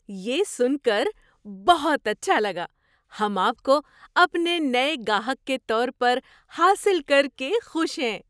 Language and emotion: Urdu, surprised